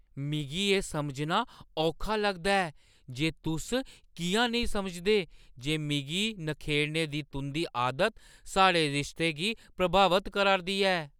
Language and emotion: Dogri, surprised